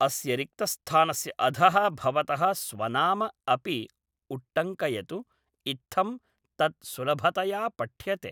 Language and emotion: Sanskrit, neutral